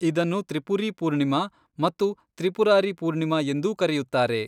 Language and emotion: Kannada, neutral